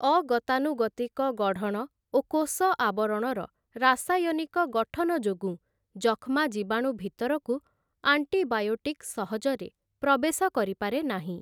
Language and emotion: Odia, neutral